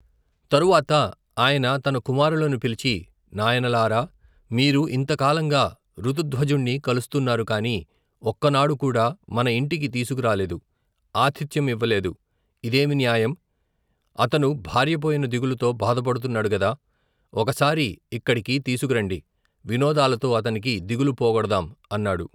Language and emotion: Telugu, neutral